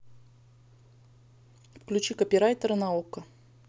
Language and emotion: Russian, neutral